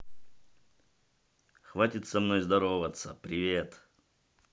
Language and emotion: Russian, neutral